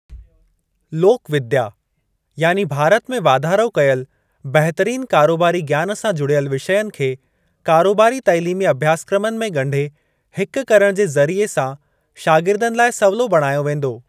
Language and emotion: Sindhi, neutral